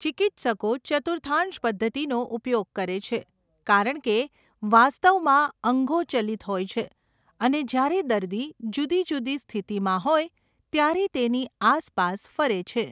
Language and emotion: Gujarati, neutral